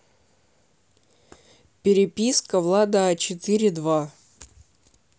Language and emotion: Russian, neutral